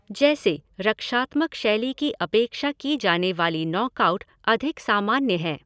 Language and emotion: Hindi, neutral